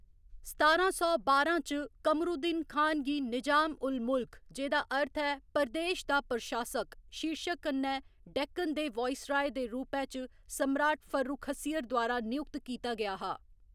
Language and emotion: Dogri, neutral